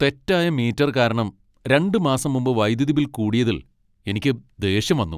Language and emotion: Malayalam, angry